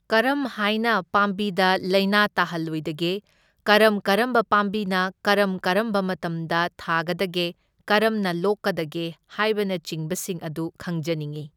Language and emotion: Manipuri, neutral